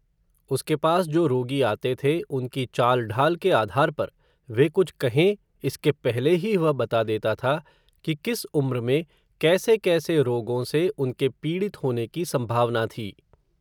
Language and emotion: Hindi, neutral